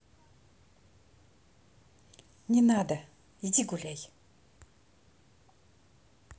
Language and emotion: Russian, angry